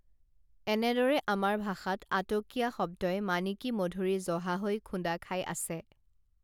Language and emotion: Assamese, neutral